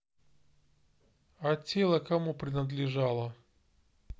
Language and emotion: Russian, neutral